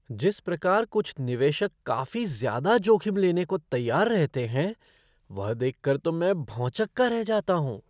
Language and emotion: Hindi, surprised